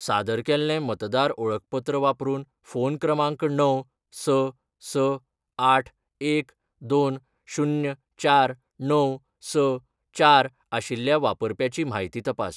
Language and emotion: Goan Konkani, neutral